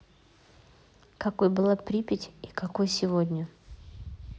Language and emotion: Russian, neutral